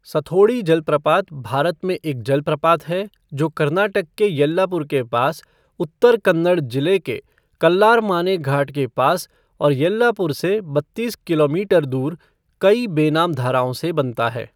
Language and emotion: Hindi, neutral